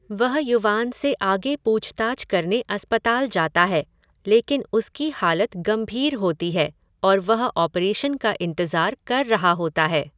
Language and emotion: Hindi, neutral